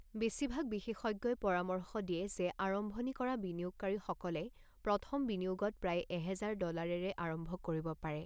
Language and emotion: Assamese, neutral